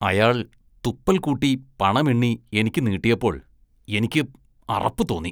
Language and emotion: Malayalam, disgusted